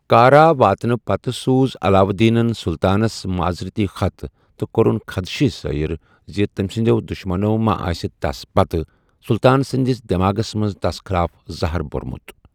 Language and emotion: Kashmiri, neutral